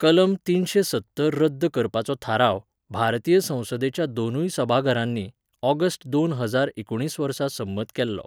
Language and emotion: Goan Konkani, neutral